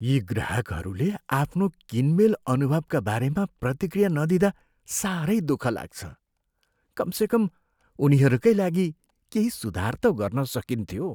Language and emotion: Nepali, sad